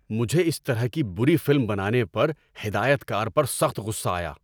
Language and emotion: Urdu, angry